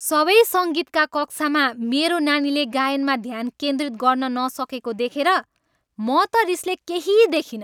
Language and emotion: Nepali, angry